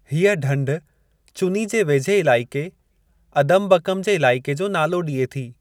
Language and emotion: Sindhi, neutral